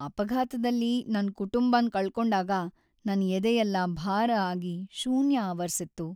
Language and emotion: Kannada, sad